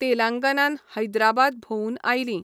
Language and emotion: Goan Konkani, neutral